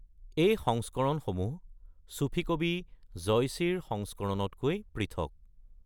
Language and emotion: Assamese, neutral